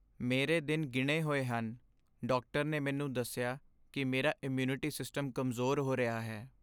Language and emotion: Punjabi, sad